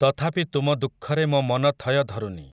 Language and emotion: Odia, neutral